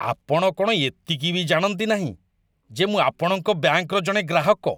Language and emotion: Odia, disgusted